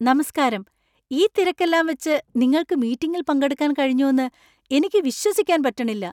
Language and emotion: Malayalam, surprised